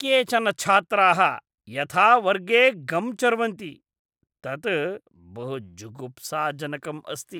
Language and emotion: Sanskrit, disgusted